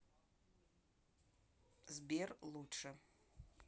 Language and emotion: Russian, neutral